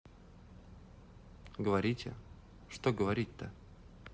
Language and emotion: Russian, neutral